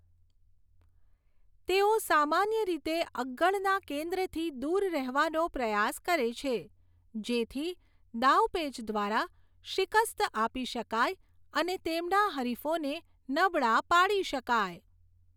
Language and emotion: Gujarati, neutral